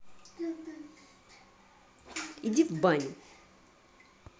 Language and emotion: Russian, angry